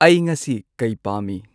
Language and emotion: Manipuri, neutral